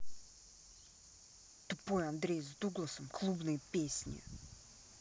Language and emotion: Russian, angry